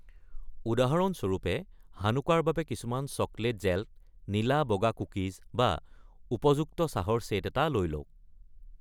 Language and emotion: Assamese, neutral